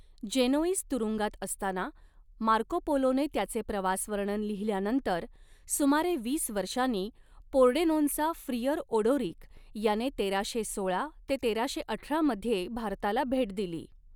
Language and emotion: Marathi, neutral